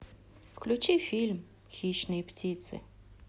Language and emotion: Russian, neutral